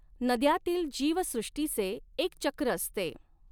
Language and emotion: Marathi, neutral